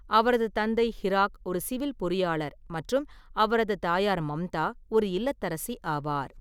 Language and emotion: Tamil, neutral